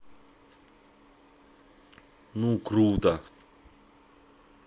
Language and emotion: Russian, positive